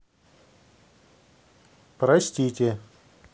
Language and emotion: Russian, neutral